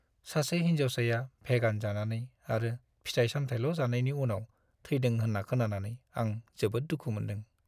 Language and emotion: Bodo, sad